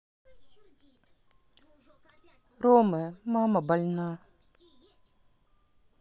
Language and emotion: Russian, sad